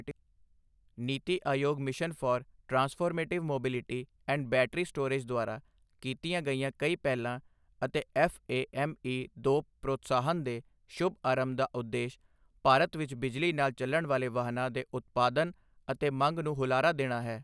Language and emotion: Punjabi, neutral